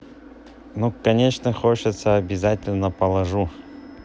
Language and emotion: Russian, neutral